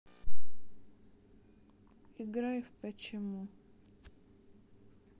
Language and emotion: Russian, sad